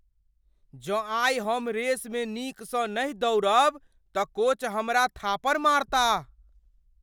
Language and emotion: Maithili, fearful